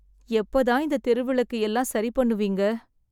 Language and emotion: Tamil, sad